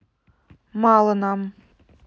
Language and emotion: Russian, neutral